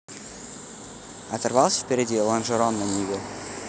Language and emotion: Russian, neutral